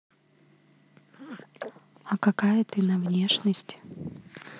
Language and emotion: Russian, neutral